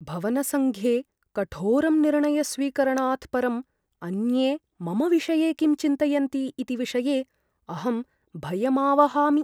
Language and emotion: Sanskrit, fearful